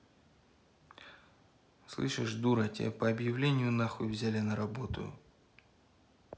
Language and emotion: Russian, angry